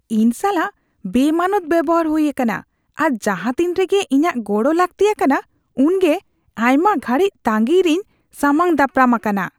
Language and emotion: Santali, disgusted